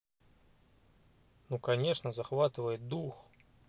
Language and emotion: Russian, neutral